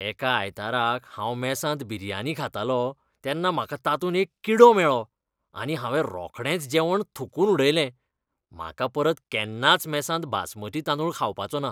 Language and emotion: Goan Konkani, disgusted